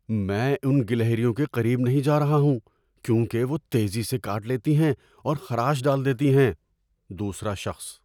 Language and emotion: Urdu, fearful